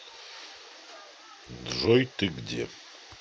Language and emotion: Russian, neutral